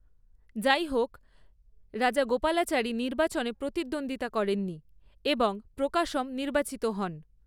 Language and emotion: Bengali, neutral